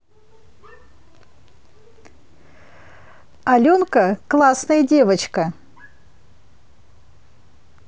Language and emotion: Russian, positive